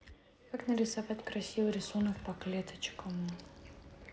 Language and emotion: Russian, neutral